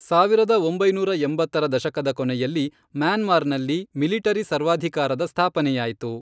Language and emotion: Kannada, neutral